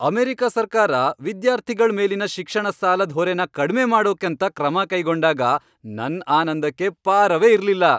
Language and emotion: Kannada, happy